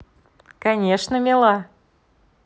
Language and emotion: Russian, positive